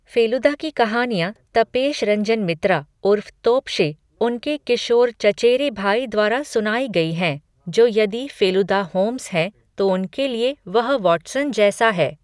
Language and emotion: Hindi, neutral